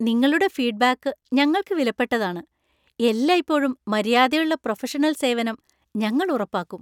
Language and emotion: Malayalam, happy